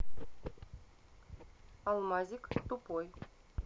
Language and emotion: Russian, neutral